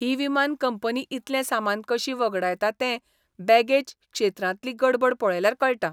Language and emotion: Goan Konkani, disgusted